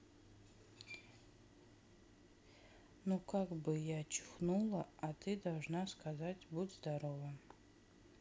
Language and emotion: Russian, sad